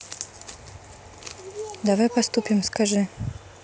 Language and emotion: Russian, neutral